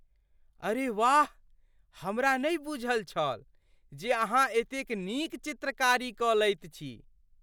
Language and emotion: Maithili, surprised